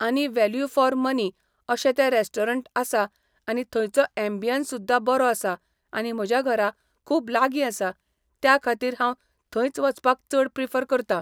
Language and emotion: Goan Konkani, neutral